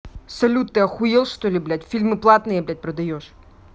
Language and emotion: Russian, angry